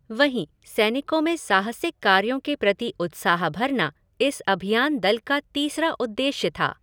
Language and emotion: Hindi, neutral